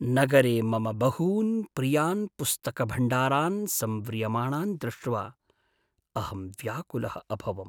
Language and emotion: Sanskrit, sad